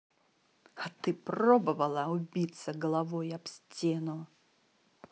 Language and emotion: Russian, angry